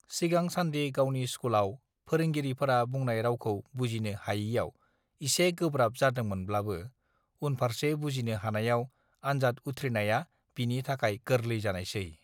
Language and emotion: Bodo, neutral